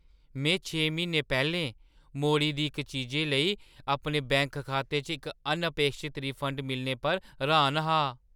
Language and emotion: Dogri, surprised